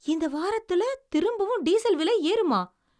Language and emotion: Tamil, surprised